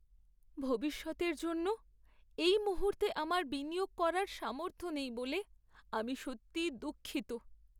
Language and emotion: Bengali, sad